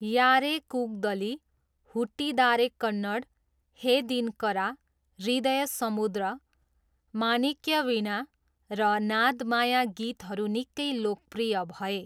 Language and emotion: Nepali, neutral